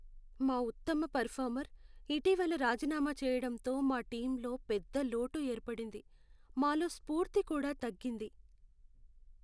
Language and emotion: Telugu, sad